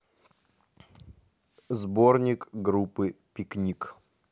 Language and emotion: Russian, neutral